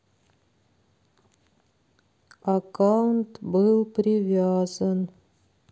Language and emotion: Russian, sad